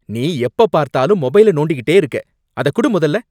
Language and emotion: Tamil, angry